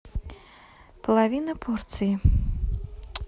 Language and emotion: Russian, neutral